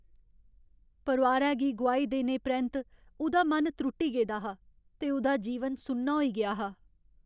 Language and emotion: Dogri, sad